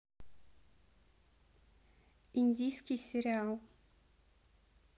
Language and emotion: Russian, neutral